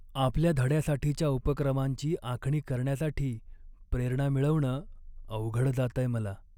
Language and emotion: Marathi, sad